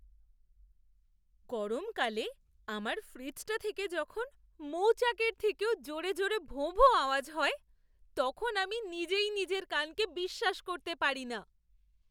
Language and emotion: Bengali, surprised